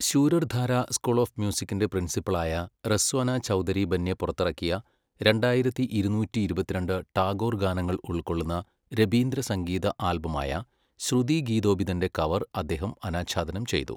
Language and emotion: Malayalam, neutral